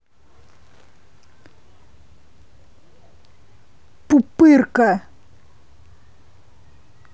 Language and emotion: Russian, angry